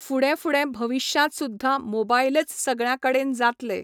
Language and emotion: Goan Konkani, neutral